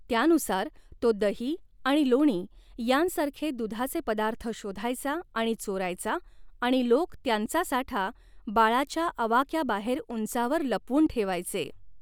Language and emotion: Marathi, neutral